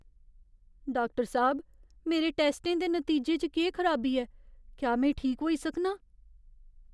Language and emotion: Dogri, fearful